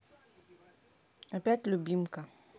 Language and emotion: Russian, neutral